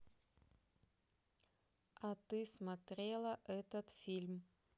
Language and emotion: Russian, neutral